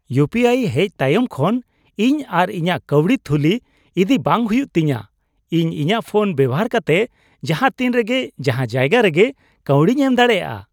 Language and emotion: Santali, happy